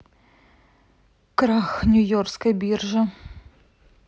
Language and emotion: Russian, sad